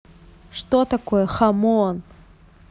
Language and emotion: Russian, angry